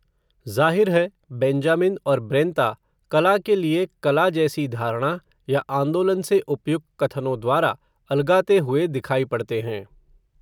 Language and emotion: Hindi, neutral